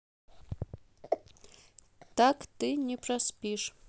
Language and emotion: Russian, neutral